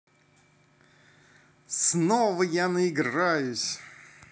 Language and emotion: Russian, positive